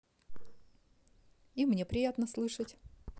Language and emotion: Russian, positive